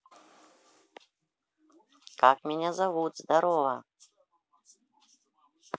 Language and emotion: Russian, positive